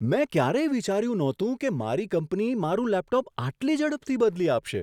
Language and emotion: Gujarati, surprised